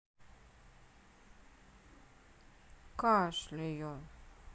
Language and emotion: Russian, sad